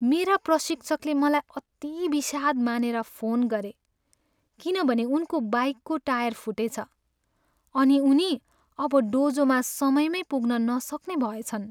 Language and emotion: Nepali, sad